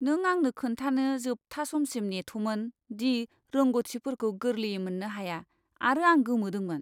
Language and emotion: Bodo, disgusted